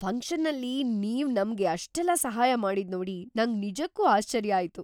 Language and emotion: Kannada, surprised